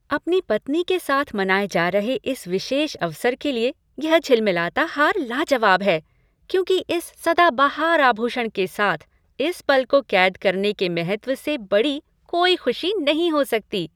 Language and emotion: Hindi, happy